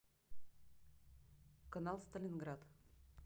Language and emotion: Russian, neutral